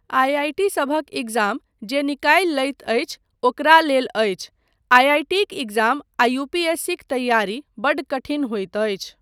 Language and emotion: Maithili, neutral